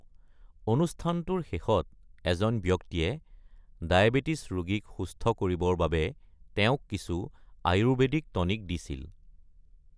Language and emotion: Assamese, neutral